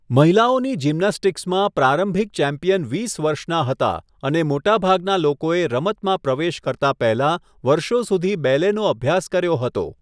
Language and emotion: Gujarati, neutral